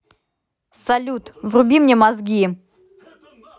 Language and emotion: Russian, angry